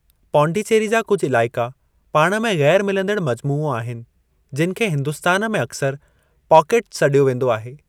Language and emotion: Sindhi, neutral